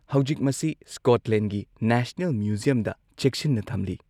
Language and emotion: Manipuri, neutral